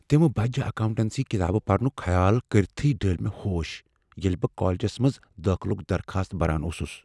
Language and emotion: Kashmiri, fearful